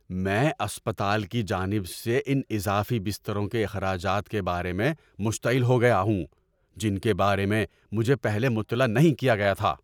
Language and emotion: Urdu, angry